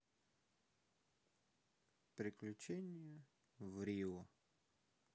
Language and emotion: Russian, sad